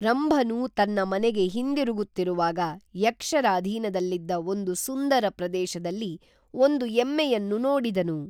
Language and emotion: Kannada, neutral